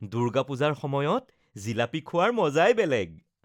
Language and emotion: Assamese, happy